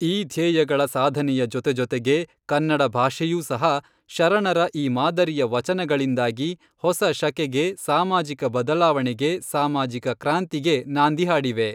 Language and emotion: Kannada, neutral